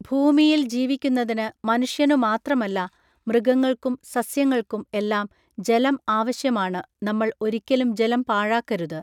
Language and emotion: Malayalam, neutral